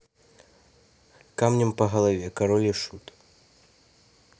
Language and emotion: Russian, neutral